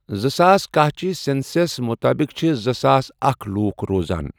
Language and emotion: Kashmiri, neutral